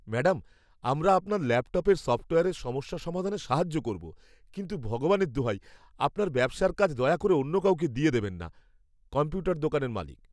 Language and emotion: Bengali, fearful